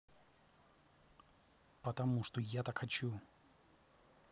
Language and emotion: Russian, neutral